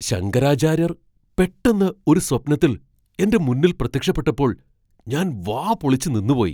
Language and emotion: Malayalam, surprised